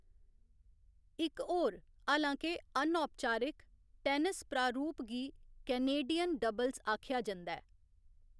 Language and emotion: Dogri, neutral